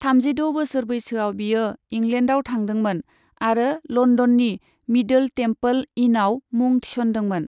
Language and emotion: Bodo, neutral